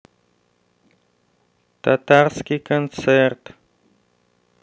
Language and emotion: Russian, neutral